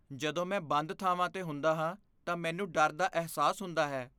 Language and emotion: Punjabi, fearful